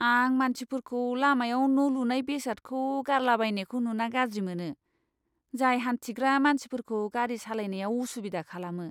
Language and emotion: Bodo, disgusted